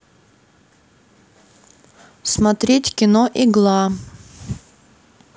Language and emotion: Russian, neutral